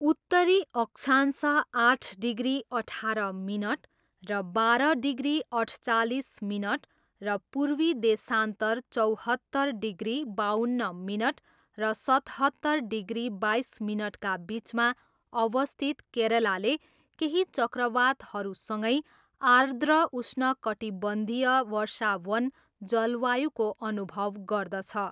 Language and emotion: Nepali, neutral